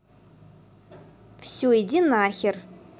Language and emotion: Russian, angry